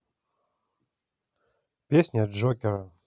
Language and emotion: Russian, neutral